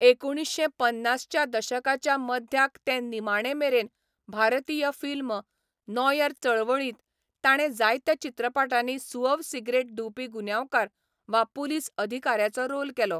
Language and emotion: Goan Konkani, neutral